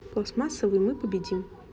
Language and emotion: Russian, neutral